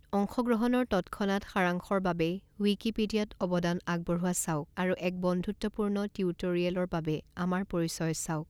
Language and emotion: Assamese, neutral